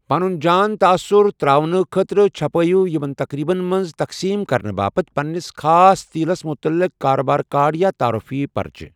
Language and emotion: Kashmiri, neutral